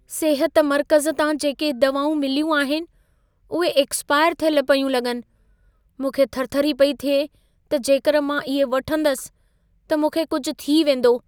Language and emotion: Sindhi, fearful